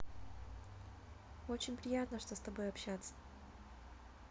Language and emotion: Russian, positive